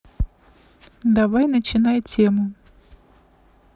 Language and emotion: Russian, neutral